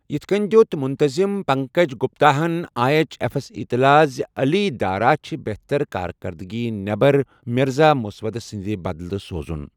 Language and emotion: Kashmiri, neutral